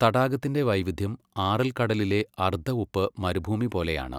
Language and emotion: Malayalam, neutral